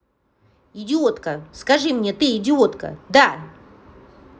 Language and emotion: Russian, angry